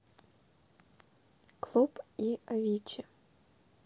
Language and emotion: Russian, neutral